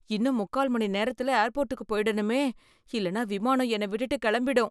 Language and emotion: Tamil, fearful